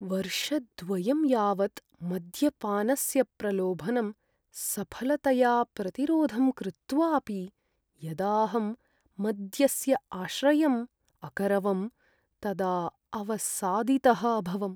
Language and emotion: Sanskrit, sad